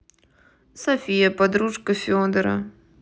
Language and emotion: Russian, neutral